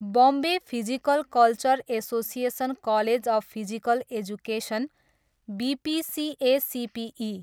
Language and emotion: Nepali, neutral